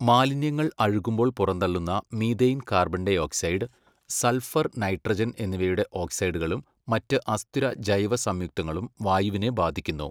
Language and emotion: Malayalam, neutral